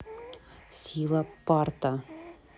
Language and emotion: Russian, neutral